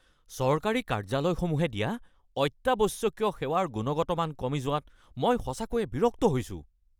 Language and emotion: Assamese, angry